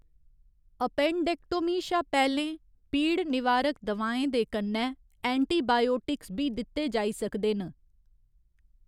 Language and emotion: Dogri, neutral